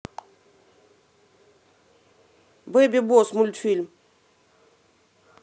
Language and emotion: Russian, neutral